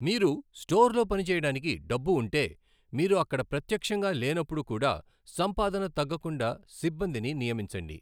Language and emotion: Telugu, neutral